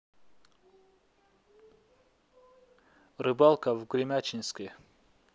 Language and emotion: Russian, neutral